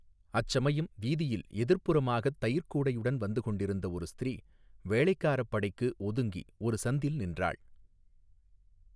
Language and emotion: Tamil, neutral